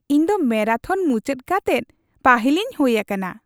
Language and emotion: Santali, happy